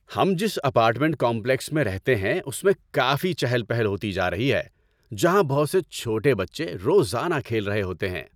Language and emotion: Urdu, happy